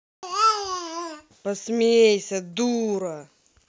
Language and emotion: Russian, angry